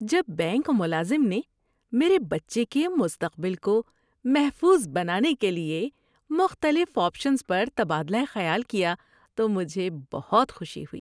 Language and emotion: Urdu, happy